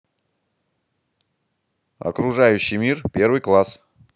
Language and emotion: Russian, positive